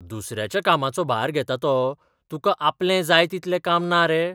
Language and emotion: Goan Konkani, surprised